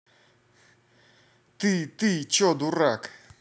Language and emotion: Russian, angry